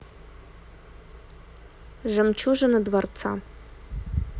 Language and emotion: Russian, neutral